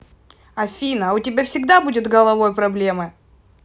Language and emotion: Russian, angry